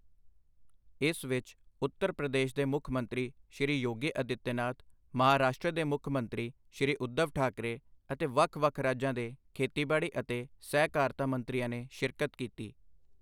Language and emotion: Punjabi, neutral